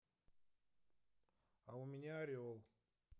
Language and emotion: Russian, neutral